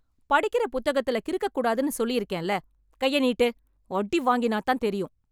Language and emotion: Tamil, angry